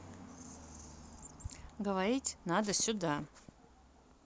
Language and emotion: Russian, neutral